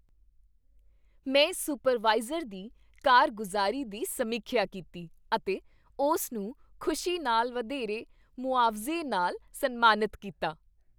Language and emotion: Punjabi, happy